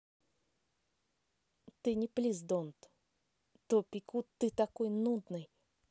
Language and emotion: Russian, neutral